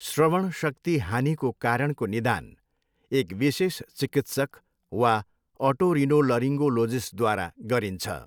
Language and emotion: Nepali, neutral